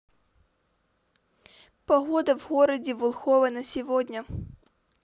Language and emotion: Russian, neutral